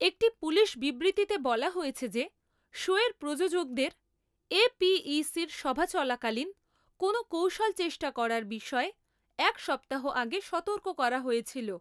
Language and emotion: Bengali, neutral